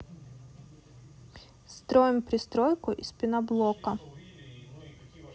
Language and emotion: Russian, neutral